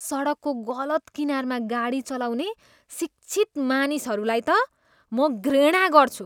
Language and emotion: Nepali, disgusted